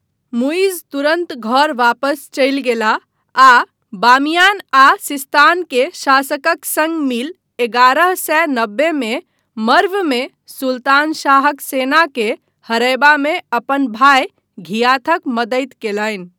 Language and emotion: Maithili, neutral